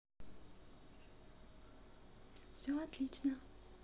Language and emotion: Russian, positive